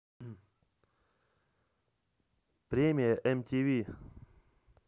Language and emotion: Russian, neutral